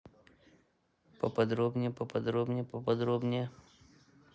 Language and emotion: Russian, neutral